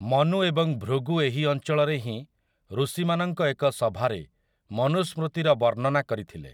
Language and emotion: Odia, neutral